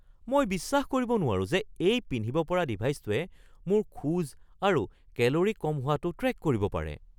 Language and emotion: Assamese, surprised